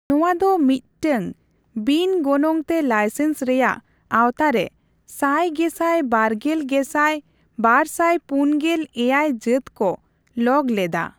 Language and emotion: Santali, neutral